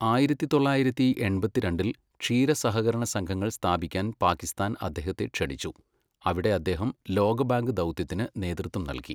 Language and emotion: Malayalam, neutral